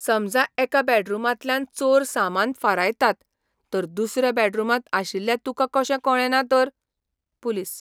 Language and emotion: Goan Konkani, surprised